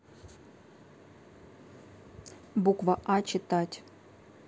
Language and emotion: Russian, neutral